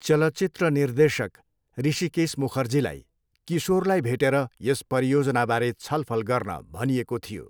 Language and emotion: Nepali, neutral